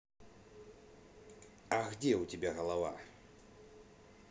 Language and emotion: Russian, neutral